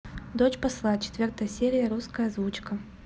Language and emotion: Russian, neutral